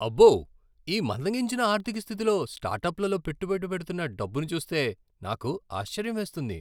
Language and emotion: Telugu, surprised